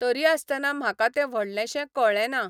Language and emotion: Goan Konkani, neutral